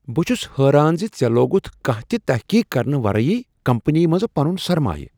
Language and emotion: Kashmiri, surprised